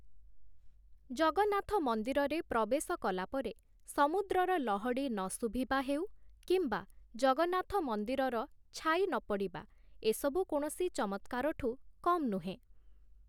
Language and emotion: Odia, neutral